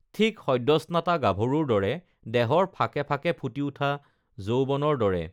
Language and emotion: Assamese, neutral